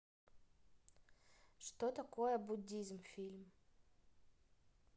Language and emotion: Russian, neutral